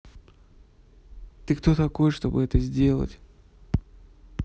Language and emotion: Russian, neutral